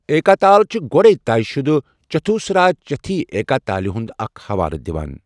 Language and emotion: Kashmiri, neutral